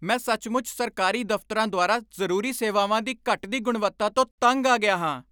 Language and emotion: Punjabi, angry